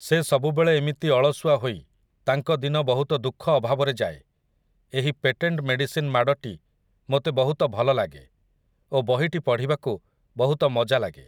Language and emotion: Odia, neutral